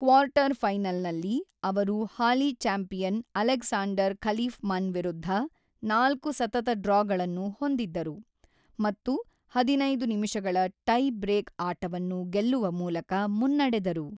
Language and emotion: Kannada, neutral